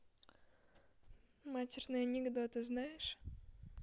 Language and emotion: Russian, neutral